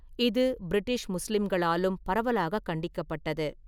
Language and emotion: Tamil, neutral